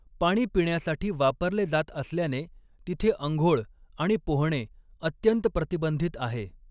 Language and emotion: Marathi, neutral